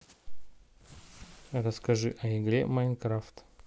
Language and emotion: Russian, neutral